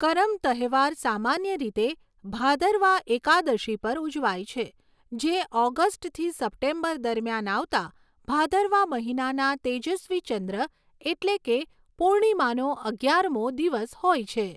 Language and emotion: Gujarati, neutral